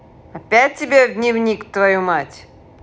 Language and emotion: Russian, angry